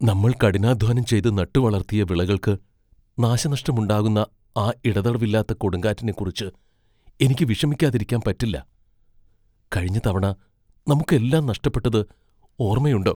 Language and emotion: Malayalam, fearful